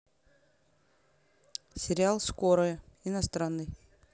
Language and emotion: Russian, neutral